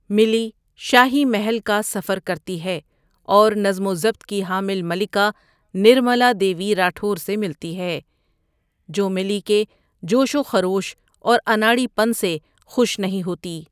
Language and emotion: Urdu, neutral